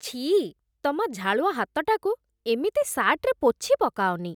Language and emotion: Odia, disgusted